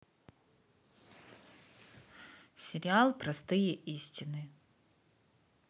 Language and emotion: Russian, neutral